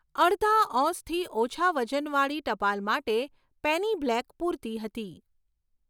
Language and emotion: Gujarati, neutral